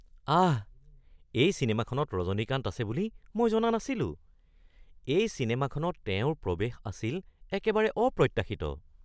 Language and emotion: Assamese, surprised